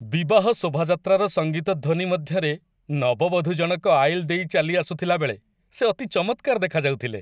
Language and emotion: Odia, happy